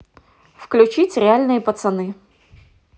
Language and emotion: Russian, positive